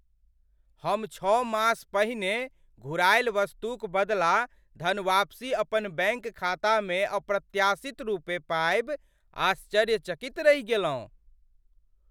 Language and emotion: Maithili, surprised